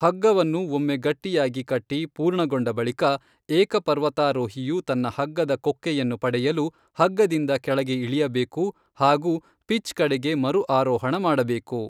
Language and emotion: Kannada, neutral